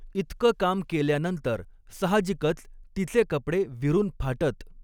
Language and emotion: Marathi, neutral